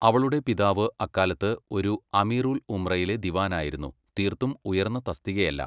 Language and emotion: Malayalam, neutral